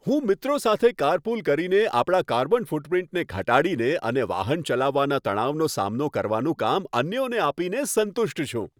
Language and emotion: Gujarati, happy